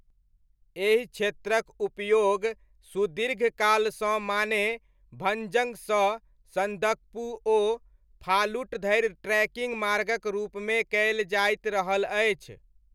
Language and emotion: Maithili, neutral